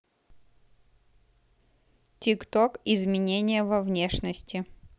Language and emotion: Russian, neutral